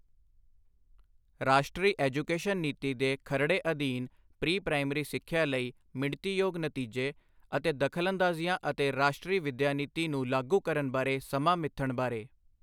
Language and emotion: Punjabi, neutral